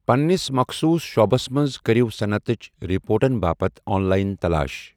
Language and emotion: Kashmiri, neutral